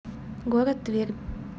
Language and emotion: Russian, neutral